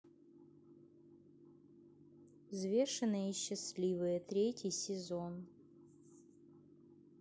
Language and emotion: Russian, neutral